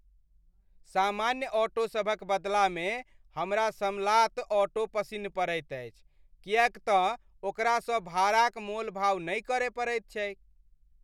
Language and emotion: Maithili, happy